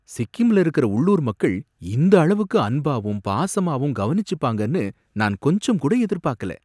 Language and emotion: Tamil, surprised